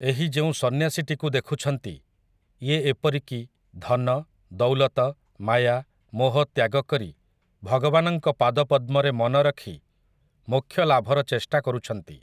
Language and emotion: Odia, neutral